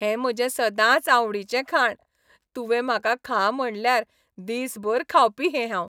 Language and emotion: Goan Konkani, happy